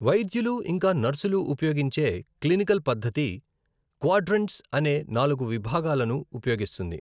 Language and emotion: Telugu, neutral